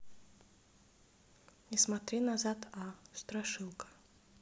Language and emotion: Russian, neutral